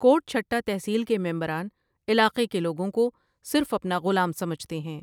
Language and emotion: Urdu, neutral